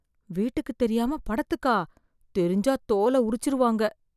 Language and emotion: Tamil, fearful